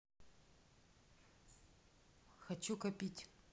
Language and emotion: Russian, neutral